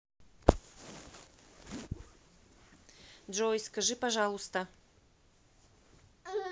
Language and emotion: Russian, neutral